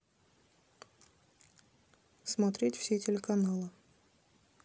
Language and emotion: Russian, neutral